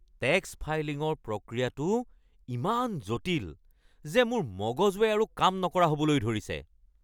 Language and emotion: Assamese, angry